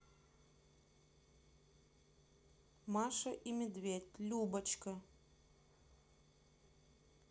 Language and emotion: Russian, neutral